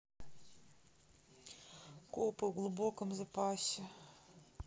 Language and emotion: Russian, sad